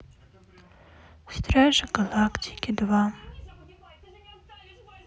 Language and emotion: Russian, sad